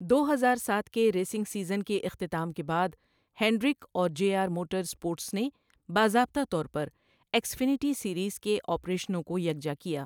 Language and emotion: Urdu, neutral